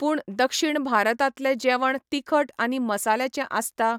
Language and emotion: Goan Konkani, neutral